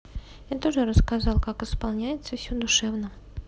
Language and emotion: Russian, neutral